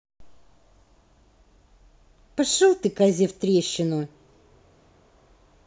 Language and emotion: Russian, angry